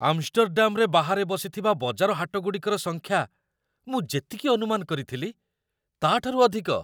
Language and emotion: Odia, surprised